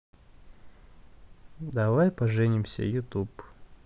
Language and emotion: Russian, neutral